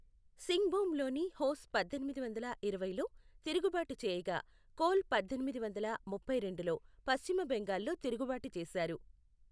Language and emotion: Telugu, neutral